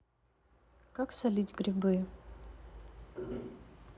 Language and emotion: Russian, neutral